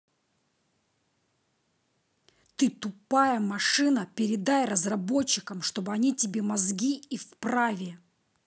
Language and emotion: Russian, angry